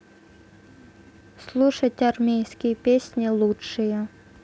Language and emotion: Russian, neutral